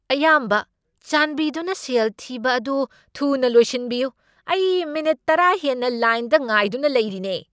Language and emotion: Manipuri, angry